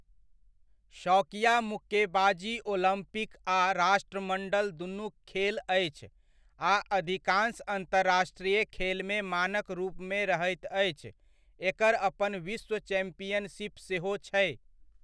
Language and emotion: Maithili, neutral